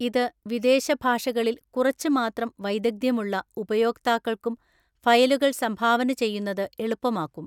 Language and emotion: Malayalam, neutral